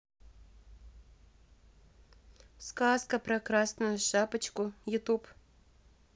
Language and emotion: Russian, neutral